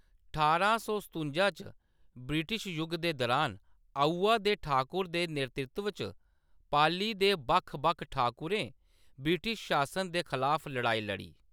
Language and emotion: Dogri, neutral